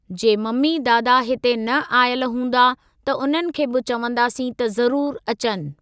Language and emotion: Sindhi, neutral